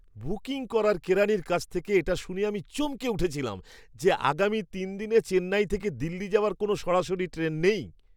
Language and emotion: Bengali, surprised